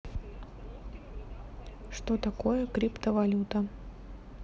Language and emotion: Russian, neutral